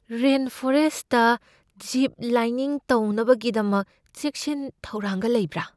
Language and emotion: Manipuri, fearful